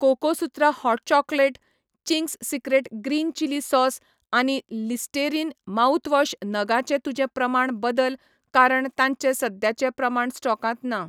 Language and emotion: Goan Konkani, neutral